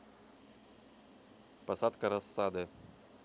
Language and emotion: Russian, neutral